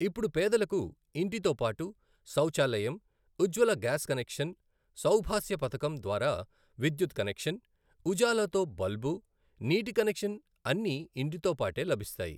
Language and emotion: Telugu, neutral